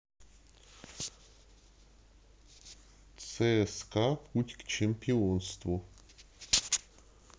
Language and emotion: Russian, neutral